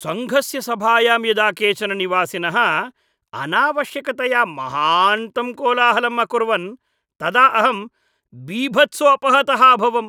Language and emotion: Sanskrit, disgusted